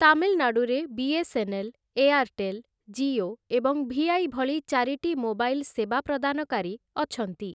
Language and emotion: Odia, neutral